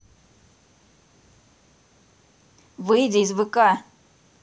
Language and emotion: Russian, angry